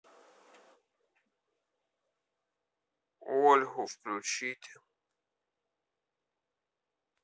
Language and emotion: Russian, neutral